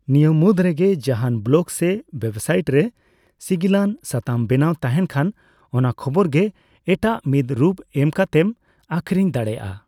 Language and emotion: Santali, neutral